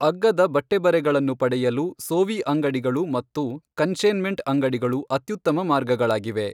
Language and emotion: Kannada, neutral